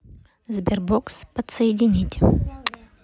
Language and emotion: Russian, neutral